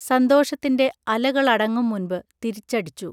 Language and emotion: Malayalam, neutral